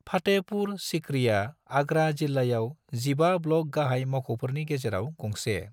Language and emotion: Bodo, neutral